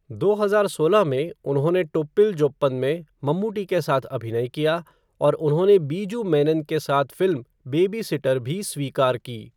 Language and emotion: Hindi, neutral